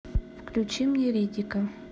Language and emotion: Russian, neutral